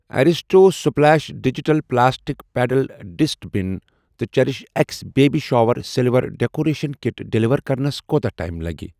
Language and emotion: Kashmiri, neutral